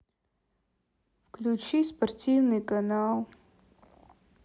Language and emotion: Russian, sad